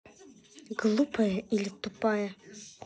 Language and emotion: Russian, angry